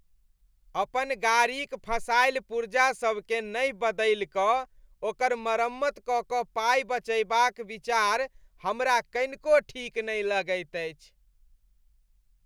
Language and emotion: Maithili, disgusted